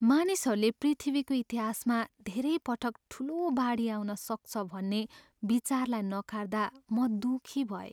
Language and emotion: Nepali, sad